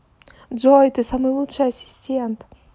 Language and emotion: Russian, positive